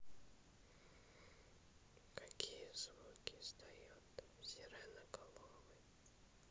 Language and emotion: Russian, neutral